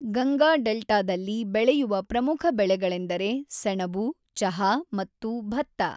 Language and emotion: Kannada, neutral